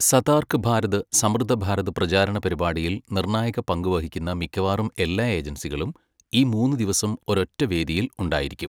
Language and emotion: Malayalam, neutral